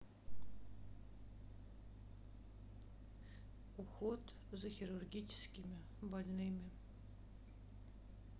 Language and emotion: Russian, sad